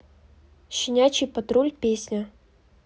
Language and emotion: Russian, neutral